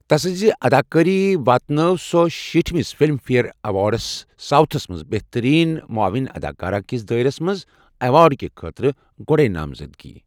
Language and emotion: Kashmiri, neutral